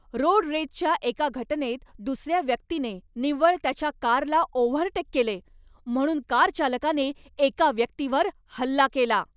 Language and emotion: Marathi, angry